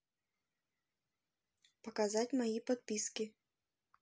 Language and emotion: Russian, neutral